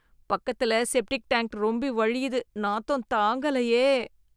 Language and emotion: Tamil, disgusted